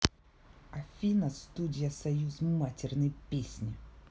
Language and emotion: Russian, angry